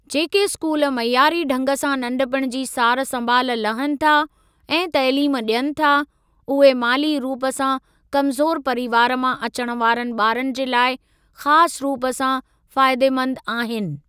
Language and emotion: Sindhi, neutral